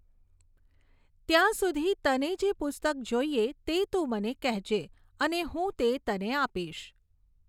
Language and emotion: Gujarati, neutral